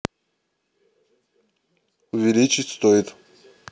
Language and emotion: Russian, neutral